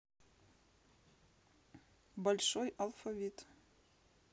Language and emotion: Russian, neutral